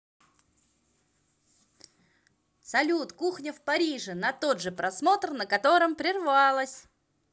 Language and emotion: Russian, positive